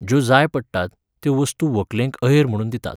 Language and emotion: Goan Konkani, neutral